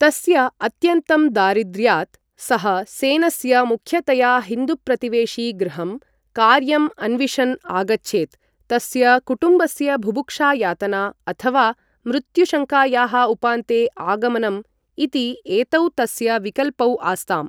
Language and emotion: Sanskrit, neutral